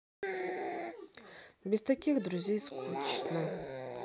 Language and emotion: Russian, sad